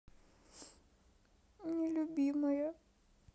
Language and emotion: Russian, sad